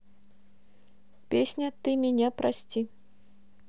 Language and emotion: Russian, neutral